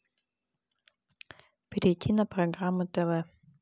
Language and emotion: Russian, neutral